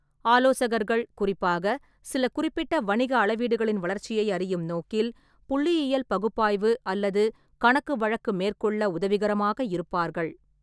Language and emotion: Tamil, neutral